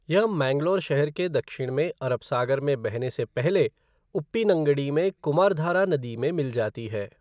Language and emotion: Hindi, neutral